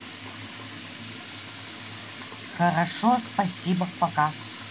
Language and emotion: Russian, neutral